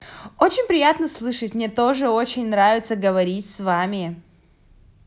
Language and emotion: Russian, positive